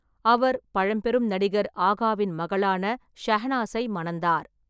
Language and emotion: Tamil, neutral